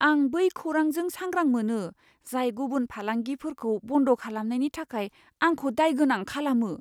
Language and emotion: Bodo, fearful